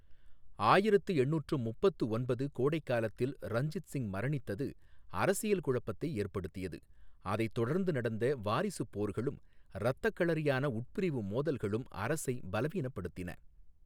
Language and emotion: Tamil, neutral